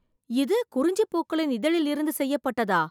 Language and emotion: Tamil, surprised